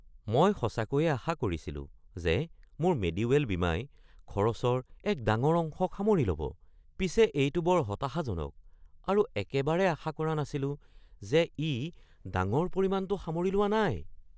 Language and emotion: Assamese, surprised